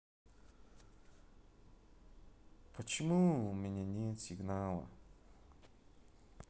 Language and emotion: Russian, sad